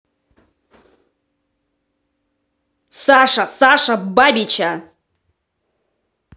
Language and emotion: Russian, angry